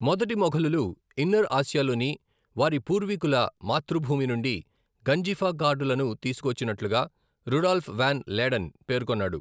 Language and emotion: Telugu, neutral